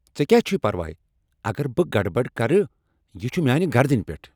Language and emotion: Kashmiri, angry